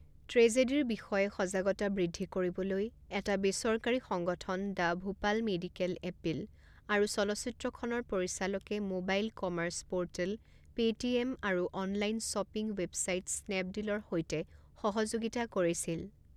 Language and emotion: Assamese, neutral